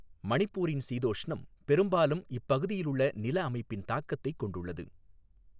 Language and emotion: Tamil, neutral